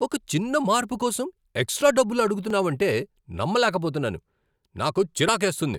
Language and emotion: Telugu, angry